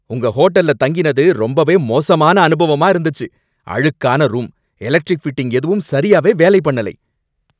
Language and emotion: Tamil, angry